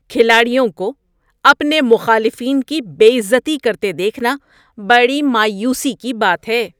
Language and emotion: Urdu, disgusted